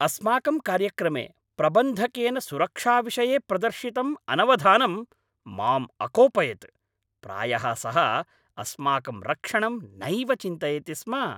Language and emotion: Sanskrit, angry